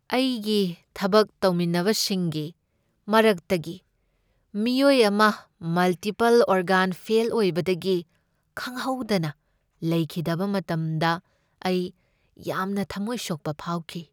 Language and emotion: Manipuri, sad